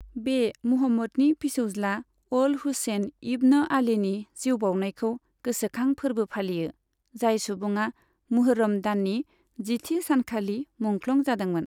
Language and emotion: Bodo, neutral